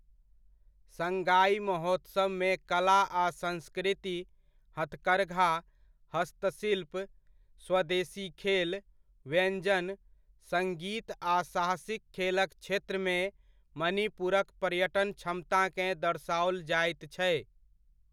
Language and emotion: Maithili, neutral